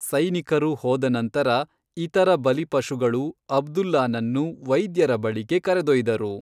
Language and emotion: Kannada, neutral